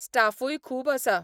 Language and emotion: Goan Konkani, neutral